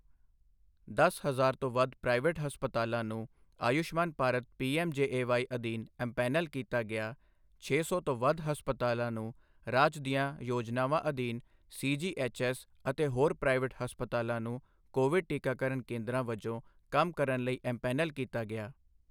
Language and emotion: Punjabi, neutral